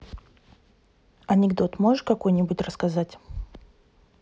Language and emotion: Russian, neutral